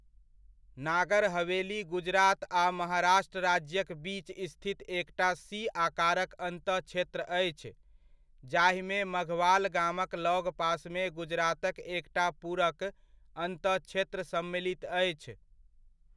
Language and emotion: Maithili, neutral